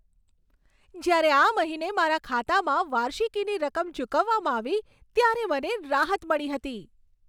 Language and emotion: Gujarati, happy